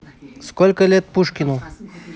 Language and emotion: Russian, neutral